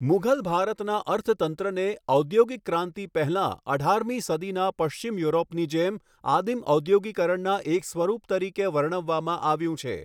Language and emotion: Gujarati, neutral